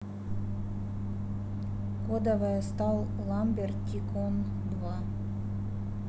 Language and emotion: Russian, neutral